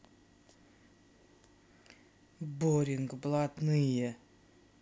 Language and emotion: Russian, angry